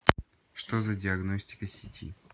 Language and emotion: Russian, neutral